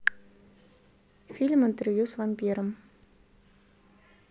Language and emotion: Russian, neutral